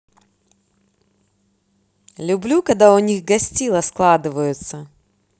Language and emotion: Russian, positive